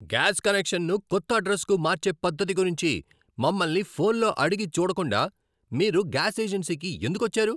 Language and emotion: Telugu, angry